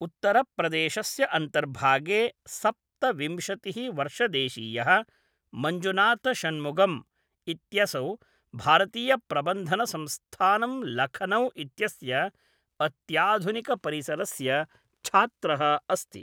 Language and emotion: Sanskrit, neutral